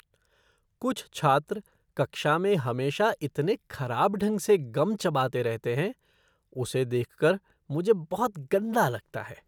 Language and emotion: Hindi, disgusted